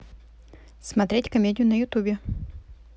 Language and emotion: Russian, neutral